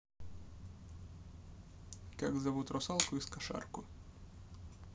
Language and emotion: Russian, neutral